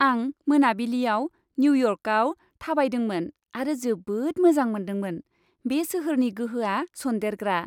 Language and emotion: Bodo, happy